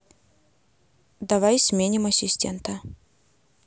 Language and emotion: Russian, neutral